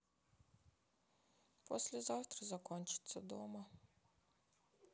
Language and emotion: Russian, sad